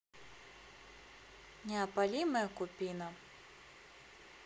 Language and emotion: Russian, neutral